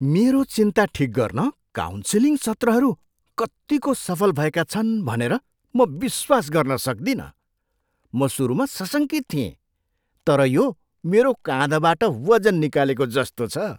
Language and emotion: Nepali, surprised